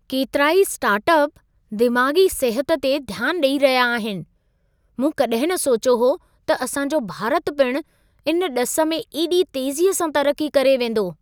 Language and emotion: Sindhi, surprised